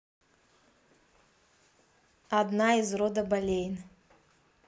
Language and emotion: Russian, neutral